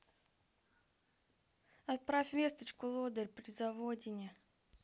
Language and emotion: Russian, neutral